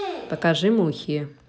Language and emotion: Russian, neutral